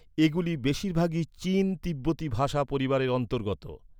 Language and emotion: Bengali, neutral